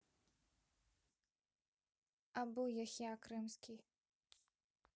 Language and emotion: Russian, neutral